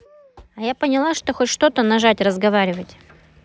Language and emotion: Russian, neutral